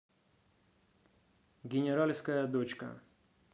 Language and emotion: Russian, neutral